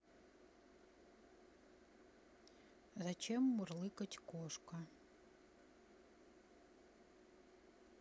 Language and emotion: Russian, neutral